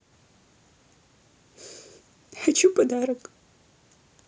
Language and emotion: Russian, sad